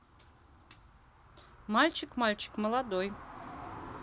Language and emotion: Russian, neutral